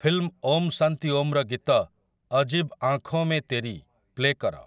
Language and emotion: Odia, neutral